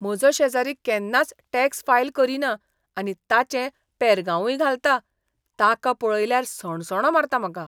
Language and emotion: Goan Konkani, disgusted